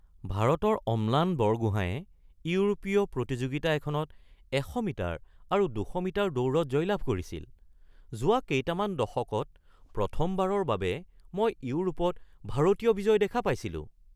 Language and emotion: Assamese, surprised